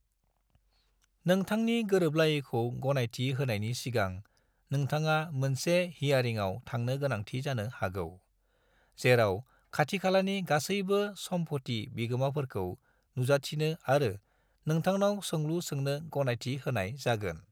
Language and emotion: Bodo, neutral